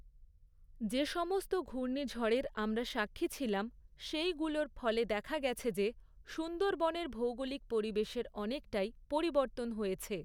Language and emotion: Bengali, neutral